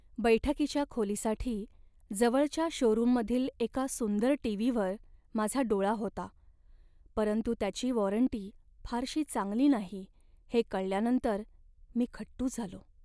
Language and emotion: Marathi, sad